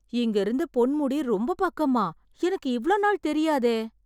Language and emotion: Tamil, surprised